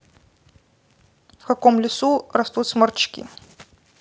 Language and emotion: Russian, neutral